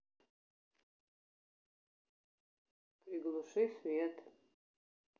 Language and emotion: Russian, neutral